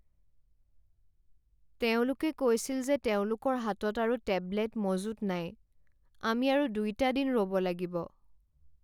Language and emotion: Assamese, sad